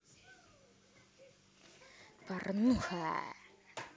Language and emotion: Russian, positive